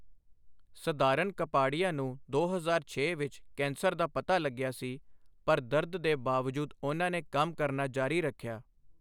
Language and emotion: Punjabi, neutral